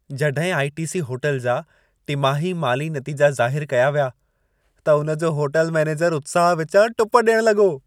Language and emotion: Sindhi, happy